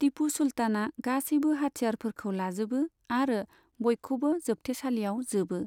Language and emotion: Bodo, neutral